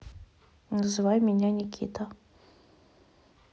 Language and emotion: Russian, neutral